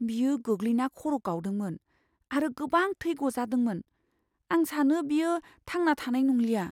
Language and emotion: Bodo, fearful